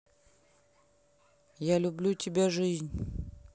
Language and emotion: Russian, neutral